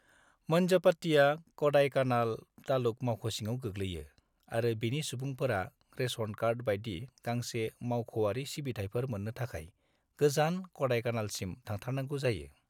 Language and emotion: Bodo, neutral